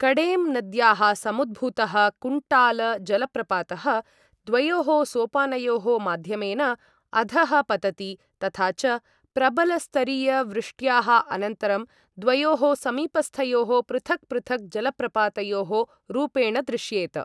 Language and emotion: Sanskrit, neutral